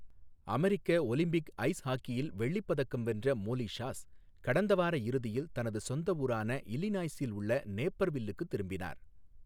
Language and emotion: Tamil, neutral